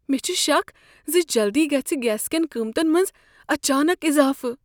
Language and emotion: Kashmiri, fearful